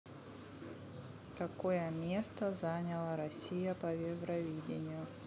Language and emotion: Russian, neutral